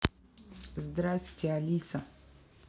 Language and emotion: Russian, neutral